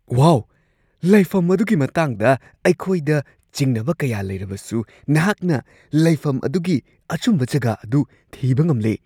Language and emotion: Manipuri, surprised